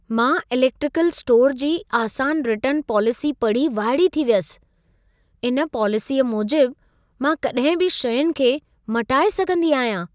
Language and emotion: Sindhi, surprised